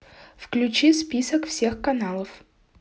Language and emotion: Russian, neutral